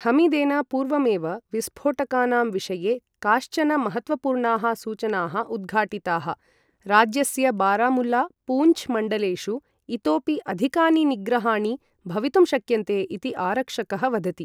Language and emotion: Sanskrit, neutral